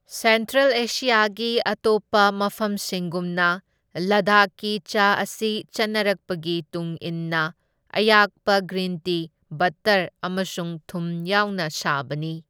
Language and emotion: Manipuri, neutral